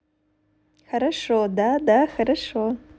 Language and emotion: Russian, positive